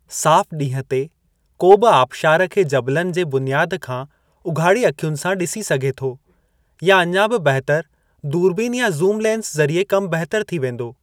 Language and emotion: Sindhi, neutral